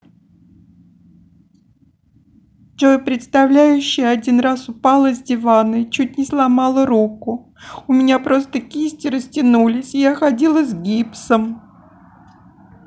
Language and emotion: Russian, sad